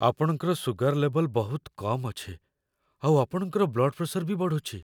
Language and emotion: Odia, fearful